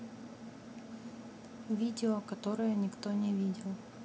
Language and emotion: Russian, neutral